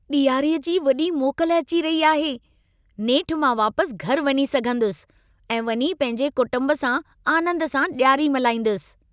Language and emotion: Sindhi, happy